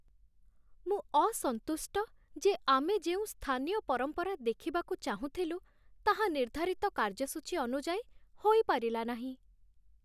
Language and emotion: Odia, sad